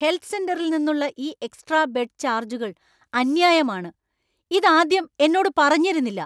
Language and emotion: Malayalam, angry